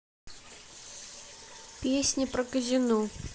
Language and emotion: Russian, neutral